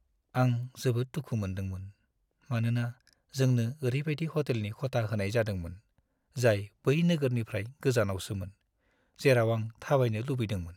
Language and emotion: Bodo, sad